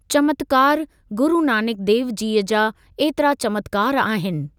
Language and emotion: Sindhi, neutral